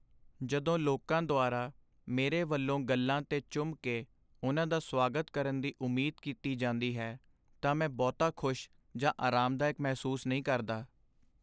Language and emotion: Punjabi, sad